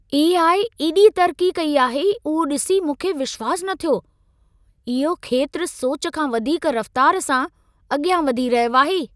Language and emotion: Sindhi, surprised